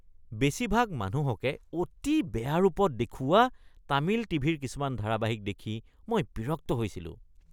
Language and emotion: Assamese, disgusted